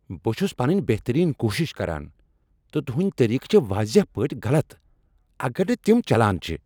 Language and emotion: Kashmiri, angry